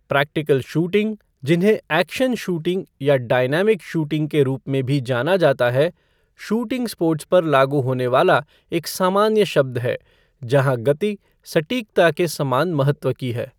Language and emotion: Hindi, neutral